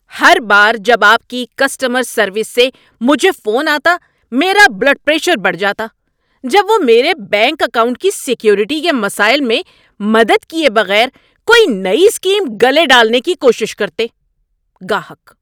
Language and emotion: Urdu, angry